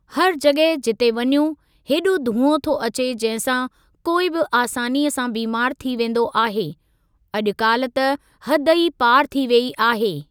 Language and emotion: Sindhi, neutral